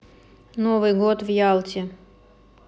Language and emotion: Russian, neutral